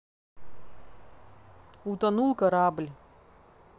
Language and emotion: Russian, neutral